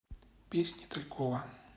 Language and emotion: Russian, neutral